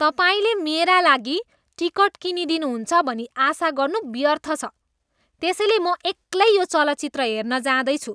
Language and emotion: Nepali, disgusted